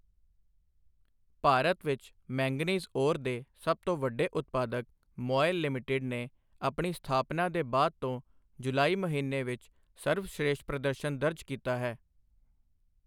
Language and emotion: Punjabi, neutral